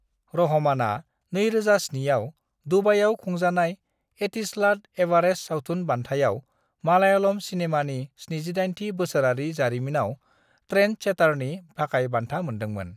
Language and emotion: Bodo, neutral